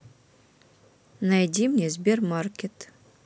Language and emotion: Russian, neutral